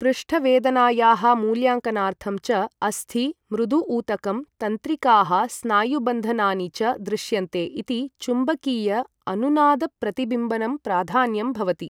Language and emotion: Sanskrit, neutral